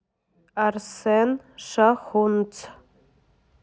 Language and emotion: Russian, neutral